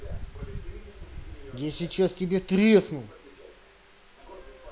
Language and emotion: Russian, angry